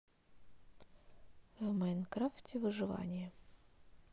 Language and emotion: Russian, neutral